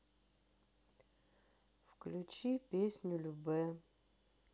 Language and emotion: Russian, sad